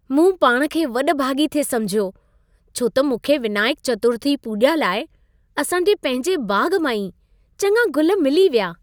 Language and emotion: Sindhi, happy